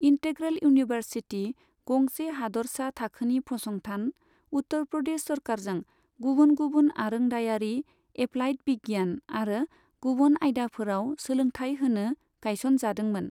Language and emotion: Bodo, neutral